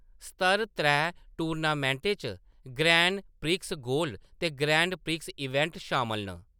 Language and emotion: Dogri, neutral